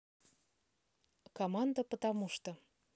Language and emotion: Russian, neutral